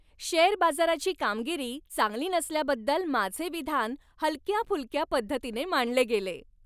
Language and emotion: Marathi, happy